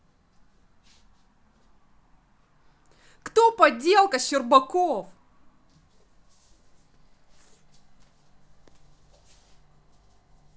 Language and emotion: Russian, angry